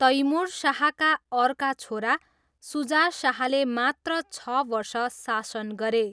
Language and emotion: Nepali, neutral